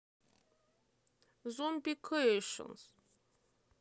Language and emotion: Russian, sad